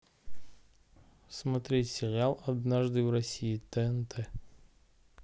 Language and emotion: Russian, neutral